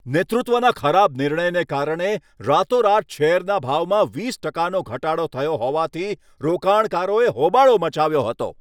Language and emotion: Gujarati, angry